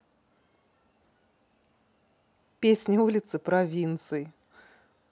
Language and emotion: Russian, positive